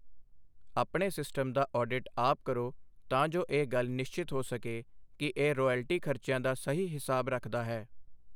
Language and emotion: Punjabi, neutral